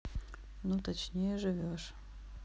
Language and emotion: Russian, neutral